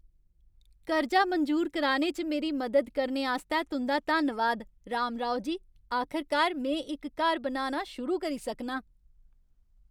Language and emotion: Dogri, happy